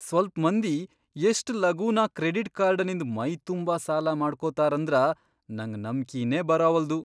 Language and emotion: Kannada, surprised